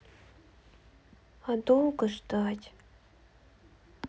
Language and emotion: Russian, sad